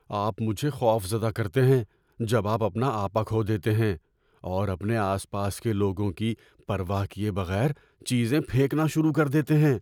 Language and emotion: Urdu, fearful